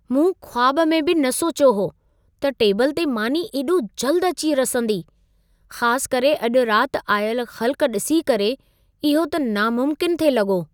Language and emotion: Sindhi, surprised